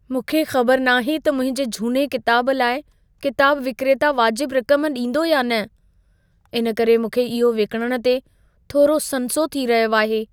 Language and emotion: Sindhi, fearful